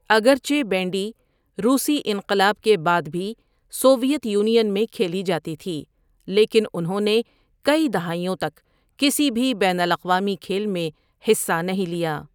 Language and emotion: Urdu, neutral